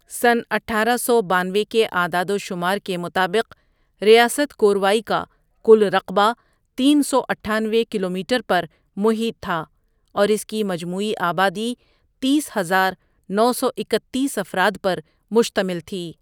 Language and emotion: Urdu, neutral